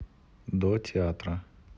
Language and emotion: Russian, neutral